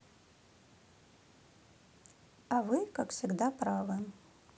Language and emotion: Russian, neutral